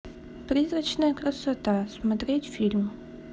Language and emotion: Russian, neutral